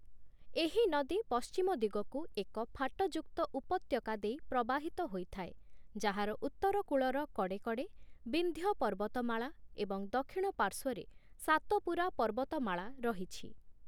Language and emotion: Odia, neutral